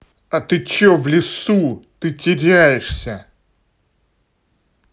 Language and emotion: Russian, angry